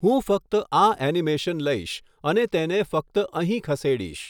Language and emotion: Gujarati, neutral